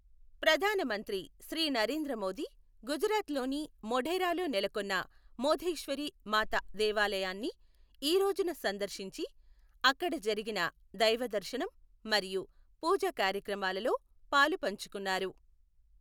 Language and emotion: Telugu, neutral